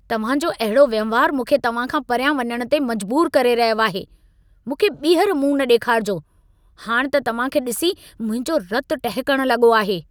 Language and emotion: Sindhi, angry